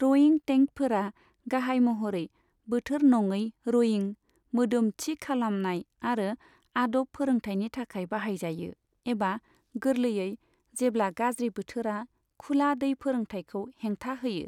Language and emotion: Bodo, neutral